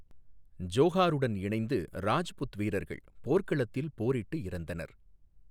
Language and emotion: Tamil, neutral